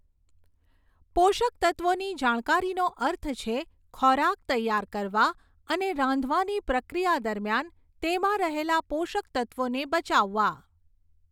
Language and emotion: Gujarati, neutral